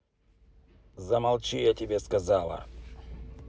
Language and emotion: Russian, angry